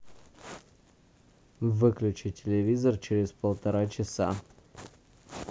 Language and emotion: Russian, neutral